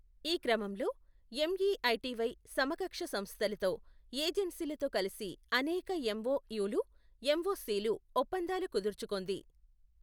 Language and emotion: Telugu, neutral